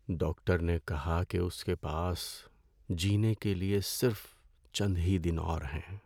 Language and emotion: Urdu, sad